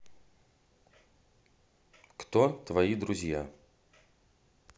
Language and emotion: Russian, neutral